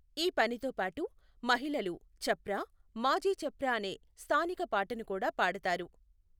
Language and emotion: Telugu, neutral